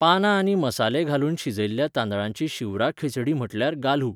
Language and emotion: Goan Konkani, neutral